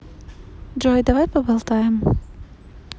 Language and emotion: Russian, neutral